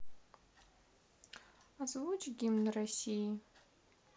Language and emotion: Russian, neutral